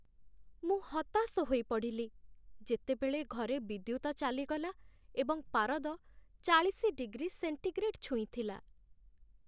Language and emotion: Odia, sad